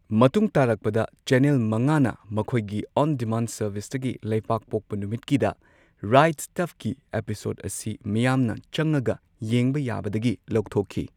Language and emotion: Manipuri, neutral